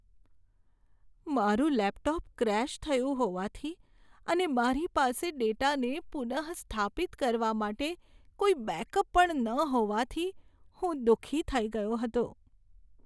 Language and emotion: Gujarati, sad